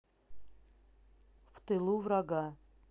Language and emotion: Russian, neutral